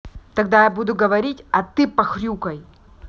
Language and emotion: Russian, angry